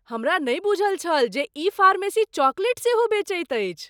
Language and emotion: Maithili, surprised